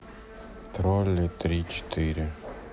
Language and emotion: Russian, sad